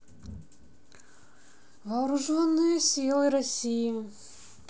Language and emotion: Russian, neutral